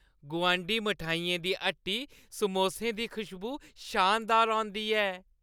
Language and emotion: Dogri, happy